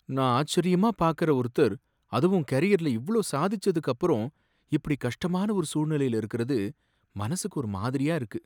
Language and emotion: Tamil, sad